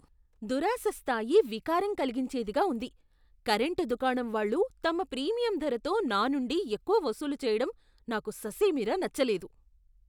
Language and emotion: Telugu, disgusted